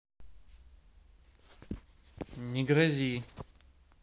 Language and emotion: Russian, neutral